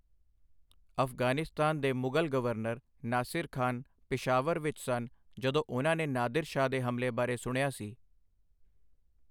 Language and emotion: Punjabi, neutral